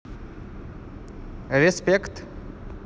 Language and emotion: Russian, positive